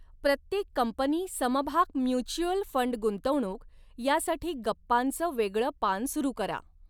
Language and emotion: Marathi, neutral